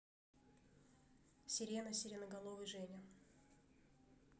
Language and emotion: Russian, neutral